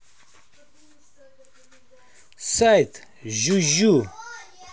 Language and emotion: Russian, neutral